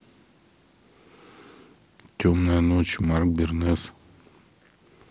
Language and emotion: Russian, neutral